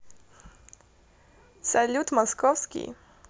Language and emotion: Russian, positive